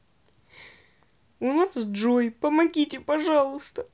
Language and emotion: Russian, sad